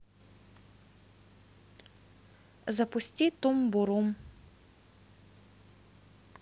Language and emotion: Russian, neutral